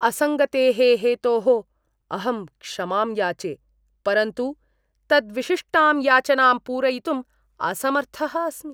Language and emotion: Sanskrit, disgusted